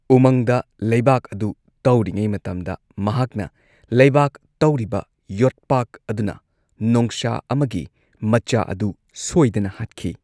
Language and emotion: Manipuri, neutral